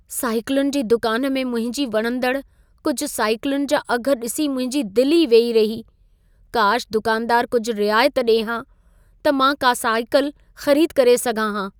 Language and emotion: Sindhi, sad